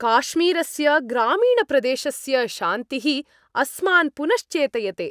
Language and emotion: Sanskrit, happy